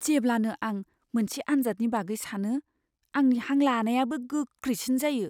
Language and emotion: Bodo, fearful